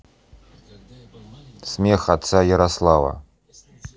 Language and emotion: Russian, neutral